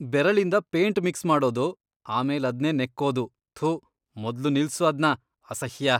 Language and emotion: Kannada, disgusted